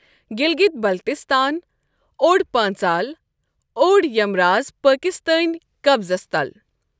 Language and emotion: Kashmiri, neutral